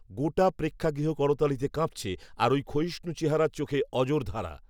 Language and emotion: Bengali, neutral